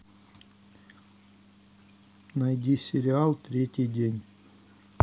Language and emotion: Russian, neutral